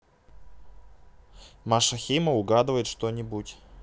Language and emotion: Russian, neutral